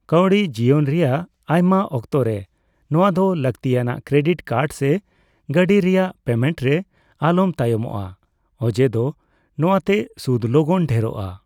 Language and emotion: Santali, neutral